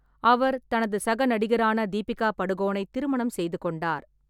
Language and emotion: Tamil, neutral